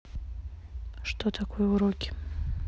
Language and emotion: Russian, neutral